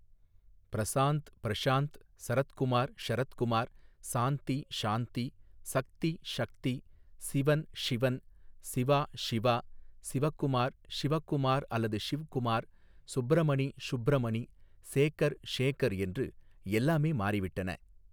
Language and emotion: Tamil, neutral